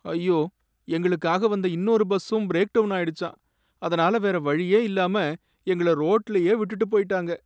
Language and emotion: Tamil, sad